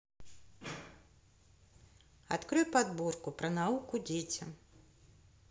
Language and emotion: Russian, neutral